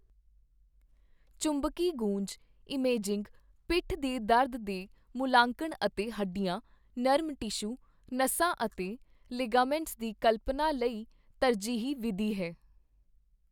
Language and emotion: Punjabi, neutral